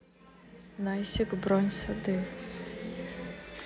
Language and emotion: Russian, neutral